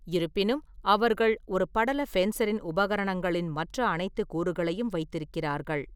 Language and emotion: Tamil, neutral